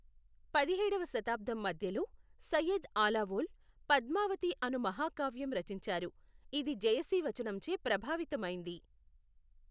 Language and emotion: Telugu, neutral